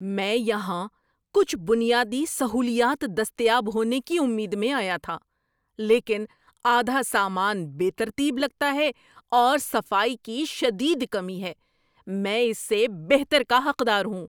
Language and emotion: Urdu, angry